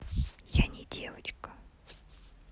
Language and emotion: Russian, neutral